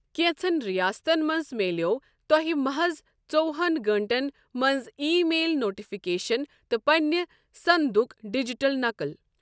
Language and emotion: Kashmiri, neutral